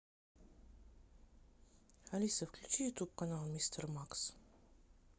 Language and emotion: Russian, neutral